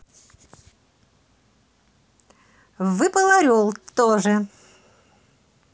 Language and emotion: Russian, positive